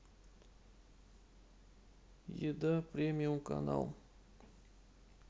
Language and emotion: Russian, sad